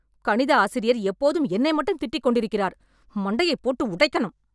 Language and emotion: Tamil, angry